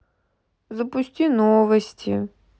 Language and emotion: Russian, sad